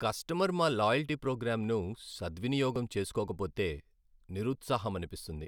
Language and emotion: Telugu, sad